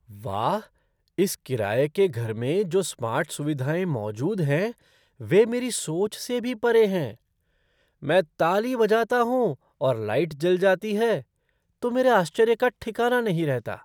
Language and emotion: Hindi, surprised